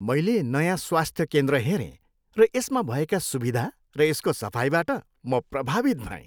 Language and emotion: Nepali, happy